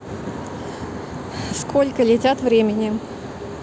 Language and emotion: Russian, neutral